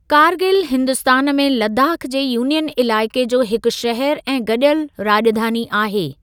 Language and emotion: Sindhi, neutral